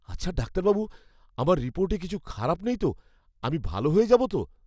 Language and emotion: Bengali, fearful